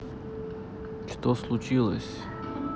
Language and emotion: Russian, neutral